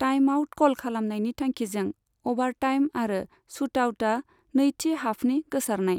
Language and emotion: Bodo, neutral